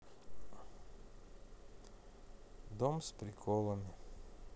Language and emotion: Russian, sad